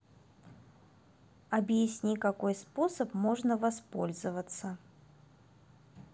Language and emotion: Russian, neutral